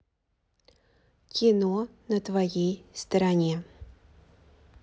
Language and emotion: Russian, neutral